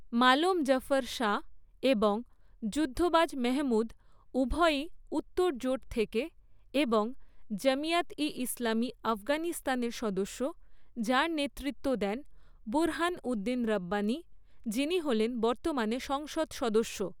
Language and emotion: Bengali, neutral